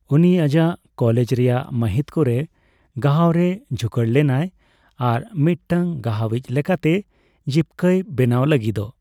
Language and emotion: Santali, neutral